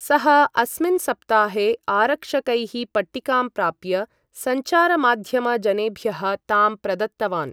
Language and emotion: Sanskrit, neutral